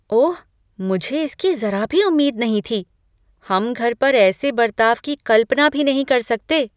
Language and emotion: Hindi, surprised